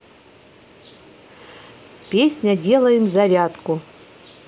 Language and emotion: Russian, neutral